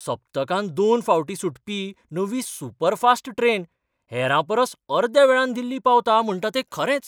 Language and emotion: Goan Konkani, surprised